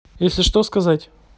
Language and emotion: Russian, neutral